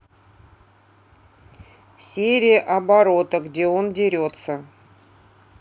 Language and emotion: Russian, neutral